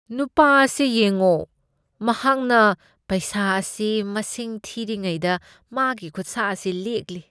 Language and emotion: Manipuri, disgusted